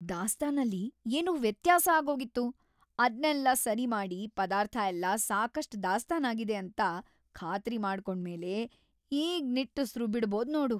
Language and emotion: Kannada, happy